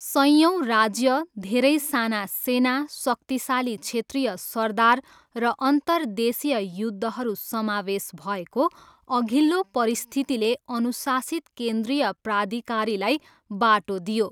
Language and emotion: Nepali, neutral